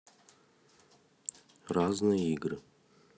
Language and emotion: Russian, neutral